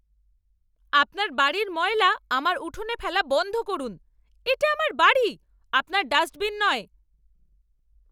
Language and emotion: Bengali, angry